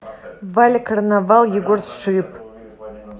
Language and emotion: Russian, neutral